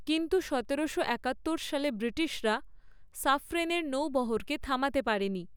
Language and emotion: Bengali, neutral